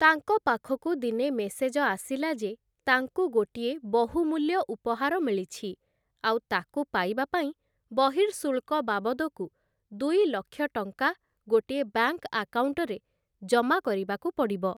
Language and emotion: Odia, neutral